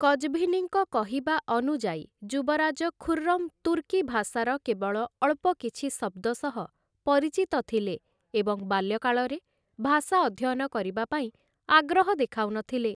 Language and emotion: Odia, neutral